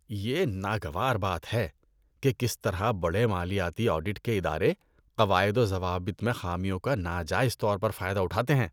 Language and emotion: Urdu, disgusted